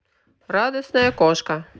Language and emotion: Russian, positive